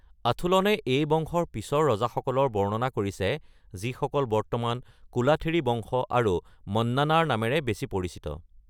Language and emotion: Assamese, neutral